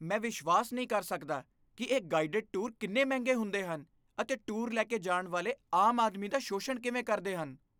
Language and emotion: Punjabi, disgusted